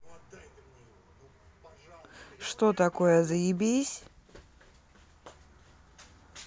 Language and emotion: Russian, neutral